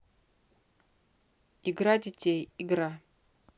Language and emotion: Russian, neutral